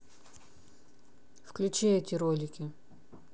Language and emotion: Russian, neutral